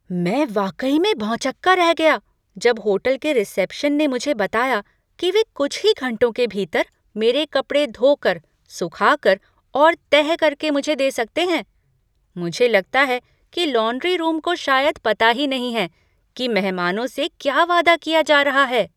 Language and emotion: Hindi, surprised